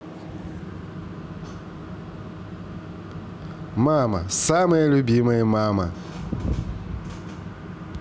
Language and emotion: Russian, positive